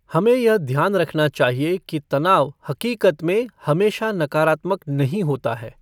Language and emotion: Hindi, neutral